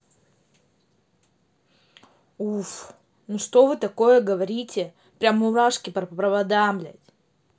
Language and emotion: Russian, angry